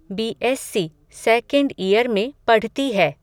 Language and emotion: Hindi, neutral